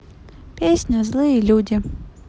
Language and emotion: Russian, neutral